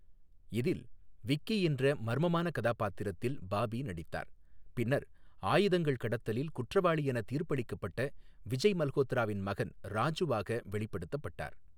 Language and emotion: Tamil, neutral